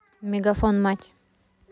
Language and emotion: Russian, neutral